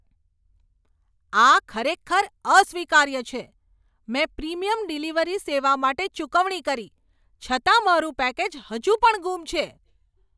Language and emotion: Gujarati, angry